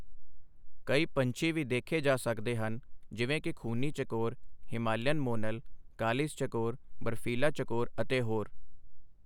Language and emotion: Punjabi, neutral